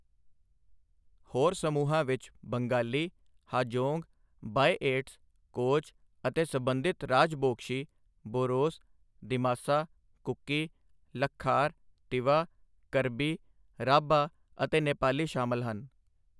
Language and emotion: Punjabi, neutral